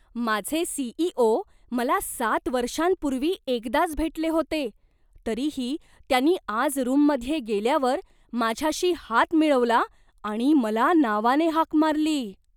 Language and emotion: Marathi, surprised